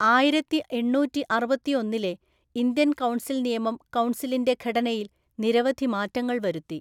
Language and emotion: Malayalam, neutral